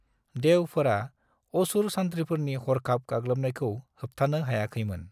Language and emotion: Bodo, neutral